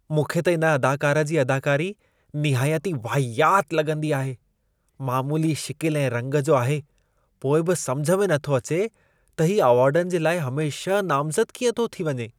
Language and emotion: Sindhi, disgusted